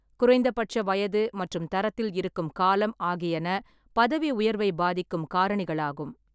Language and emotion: Tamil, neutral